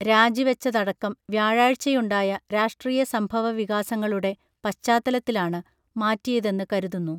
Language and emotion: Malayalam, neutral